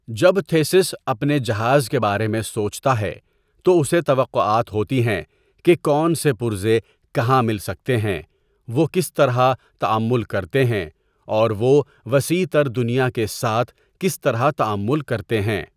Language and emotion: Urdu, neutral